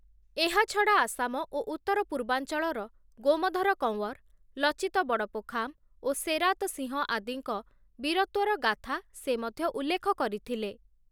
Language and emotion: Odia, neutral